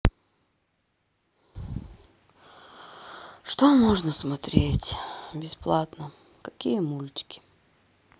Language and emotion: Russian, sad